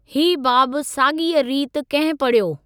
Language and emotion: Sindhi, neutral